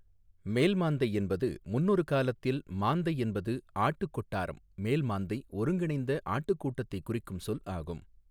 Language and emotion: Tamil, neutral